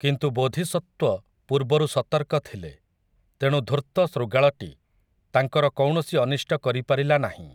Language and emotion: Odia, neutral